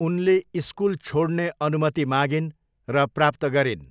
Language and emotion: Nepali, neutral